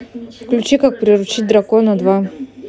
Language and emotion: Russian, neutral